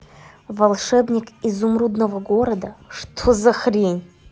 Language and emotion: Russian, angry